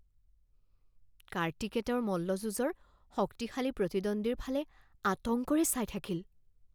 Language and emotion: Assamese, fearful